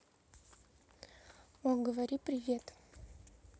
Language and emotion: Russian, neutral